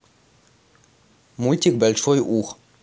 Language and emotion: Russian, neutral